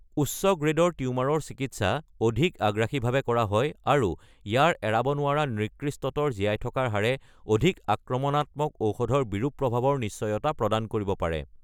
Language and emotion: Assamese, neutral